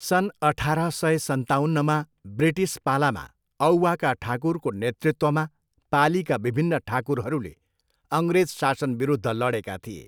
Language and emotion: Nepali, neutral